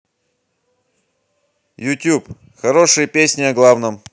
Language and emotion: Russian, neutral